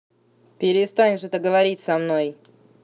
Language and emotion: Russian, angry